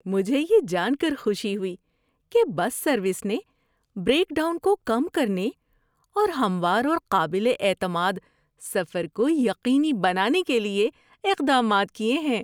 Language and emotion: Urdu, happy